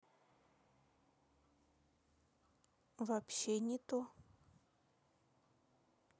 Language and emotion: Russian, neutral